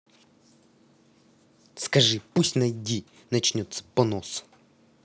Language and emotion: Russian, angry